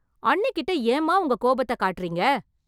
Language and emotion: Tamil, angry